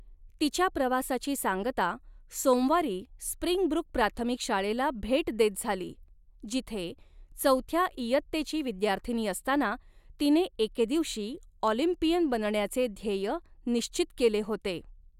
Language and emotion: Marathi, neutral